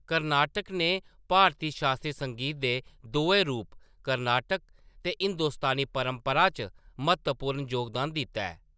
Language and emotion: Dogri, neutral